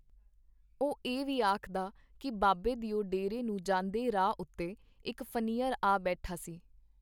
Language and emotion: Punjabi, neutral